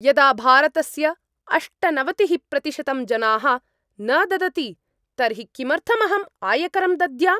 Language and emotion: Sanskrit, angry